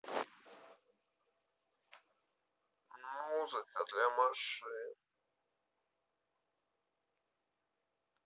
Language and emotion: Russian, sad